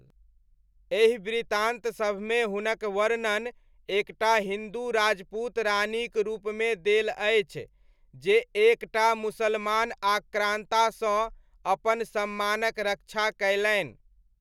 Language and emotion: Maithili, neutral